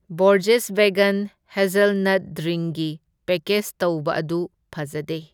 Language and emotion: Manipuri, neutral